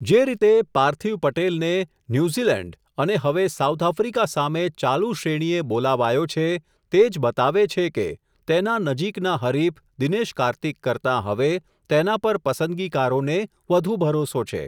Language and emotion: Gujarati, neutral